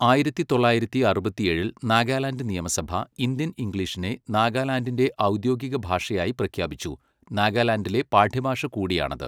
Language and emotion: Malayalam, neutral